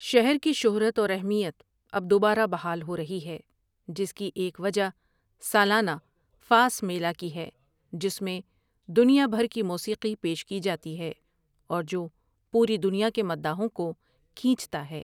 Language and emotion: Urdu, neutral